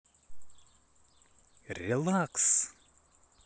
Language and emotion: Russian, positive